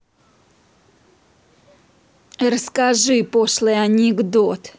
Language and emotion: Russian, angry